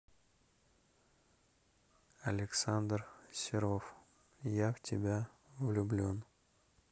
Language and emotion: Russian, neutral